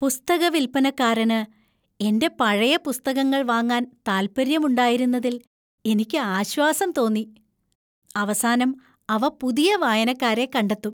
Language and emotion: Malayalam, happy